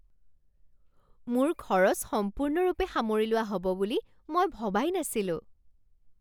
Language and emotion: Assamese, surprised